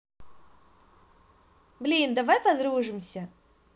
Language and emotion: Russian, positive